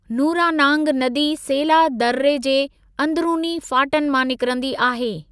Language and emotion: Sindhi, neutral